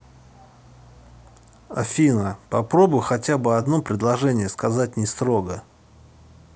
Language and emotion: Russian, neutral